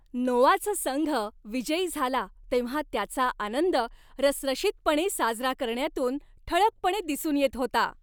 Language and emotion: Marathi, happy